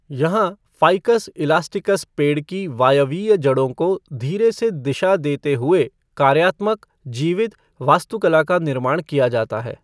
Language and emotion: Hindi, neutral